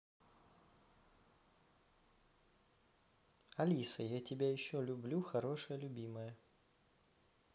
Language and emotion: Russian, positive